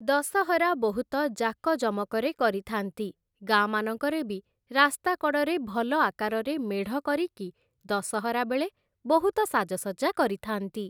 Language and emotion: Odia, neutral